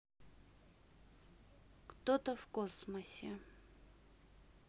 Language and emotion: Russian, sad